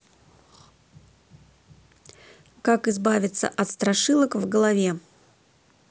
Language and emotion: Russian, neutral